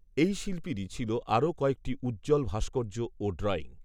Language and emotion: Bengali, neutral